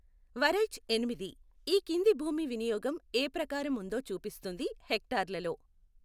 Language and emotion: Telugu, neutral